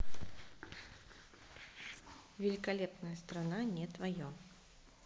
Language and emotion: Russian, neutral